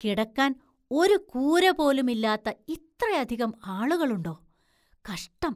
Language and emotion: Malayalam, surprised